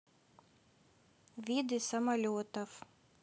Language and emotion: Russian, neutral